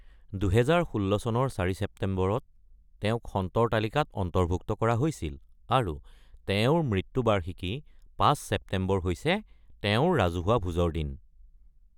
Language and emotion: Assamese, neutral